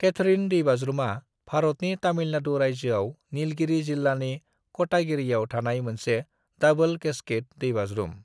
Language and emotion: Bodo, neutral